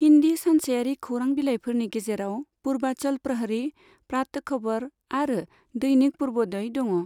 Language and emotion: Bodo, neutral